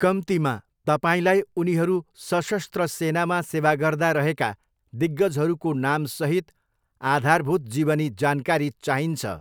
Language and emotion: Nepali, neutral